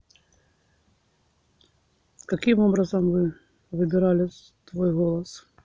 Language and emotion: Russian, neutral